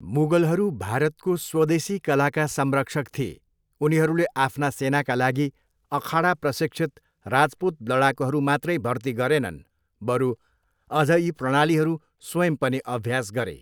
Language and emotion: Nepali, neutral